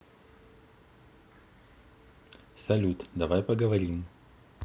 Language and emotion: Russian, neutral